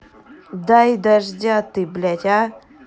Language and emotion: Russian, angry